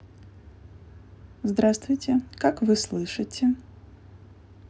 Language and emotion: Russian, neutral